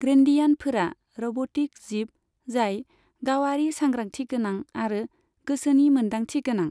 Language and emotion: Bodo, neutral